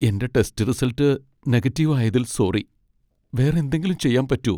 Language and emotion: Malayalam, sad